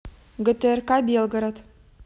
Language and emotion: Russian, neutral